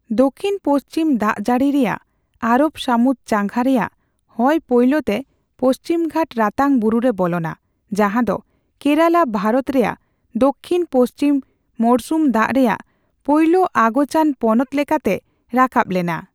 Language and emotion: Santali, neutral